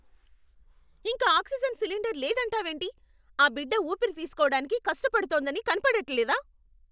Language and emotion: Telugu, angry